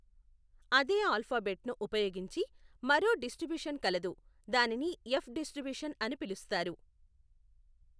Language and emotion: Telugu, neutral